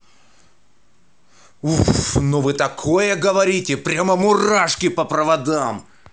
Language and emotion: Russian, angry